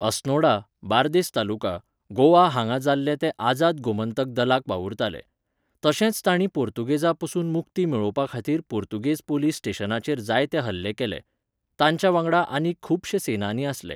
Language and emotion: Goan Konkani, neutral